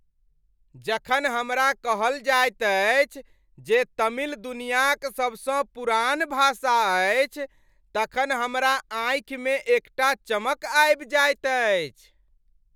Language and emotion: Maithili, happy